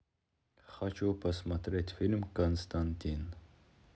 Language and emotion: Russian, neutral